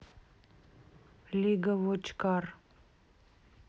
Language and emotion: Russian, neutral